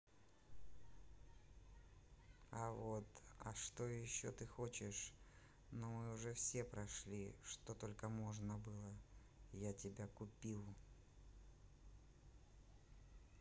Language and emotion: Russian, neutral